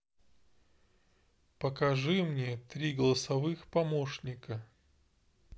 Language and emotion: Russian, neutral